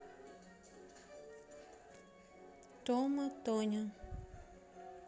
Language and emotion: Russian, neutral